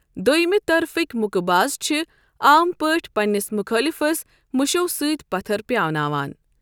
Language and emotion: Kashmiri, neutral